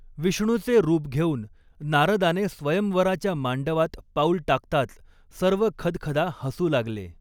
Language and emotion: Marathi, neutral